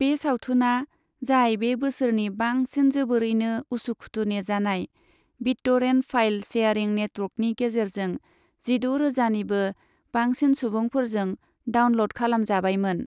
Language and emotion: Bodo, neutral